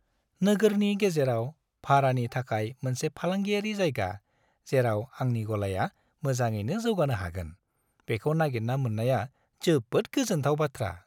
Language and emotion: Bodo, happy